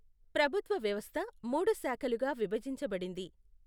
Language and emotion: Telugu, neutral